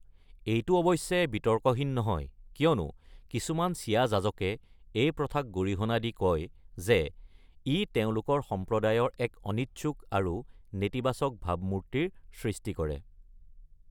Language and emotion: Assamese, neutral